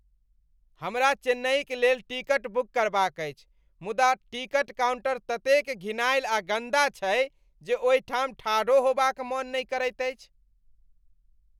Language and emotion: Maithili, disgusted